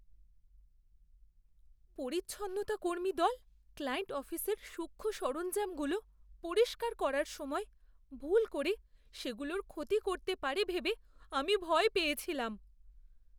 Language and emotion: Bengali, fearful